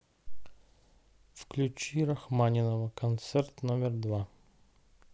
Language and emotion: Russian, neutral